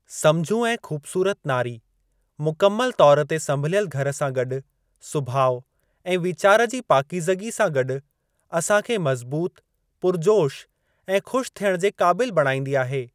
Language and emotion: Sindhi, neutral